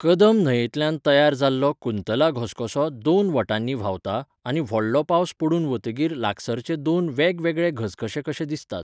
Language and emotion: Goan Konkani, neutral